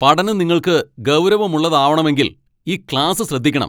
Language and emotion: Malayalam, angry